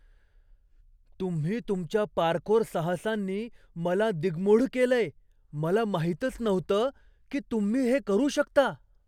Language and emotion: Marathi, surprised